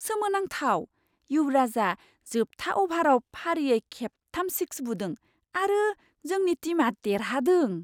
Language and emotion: Bodo, surprised